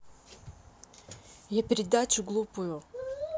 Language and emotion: Russian, angry